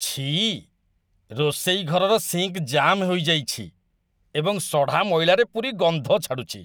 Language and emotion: Odia, disgusted